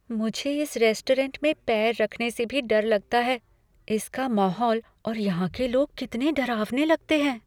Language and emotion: Hindi, fearful